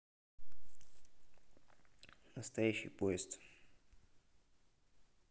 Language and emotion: Russian, neutral